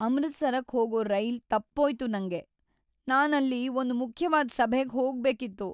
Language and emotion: Kannada, sad